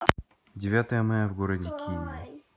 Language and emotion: Russian, neutral